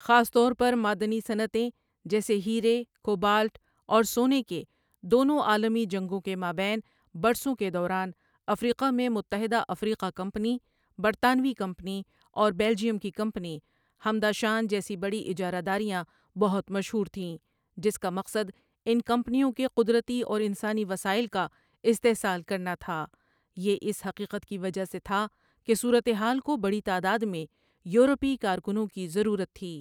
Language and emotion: Urdu, neutral